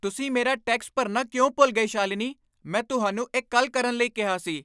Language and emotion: Punjabi, angry